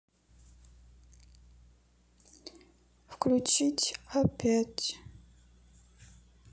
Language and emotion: Russian, sad